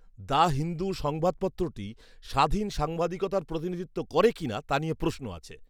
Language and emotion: Bengali, disgusted